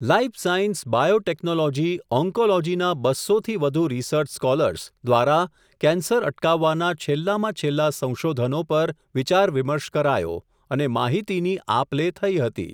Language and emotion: Gujarati, neutral